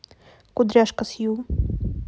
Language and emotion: Russian, neutral